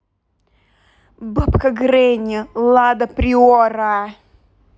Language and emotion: Russian, angry